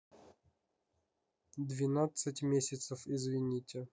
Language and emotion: Russian, neutral